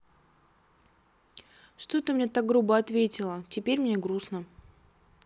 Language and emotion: Russian, sad